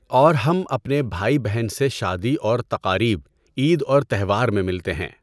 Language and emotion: Urdu, neutral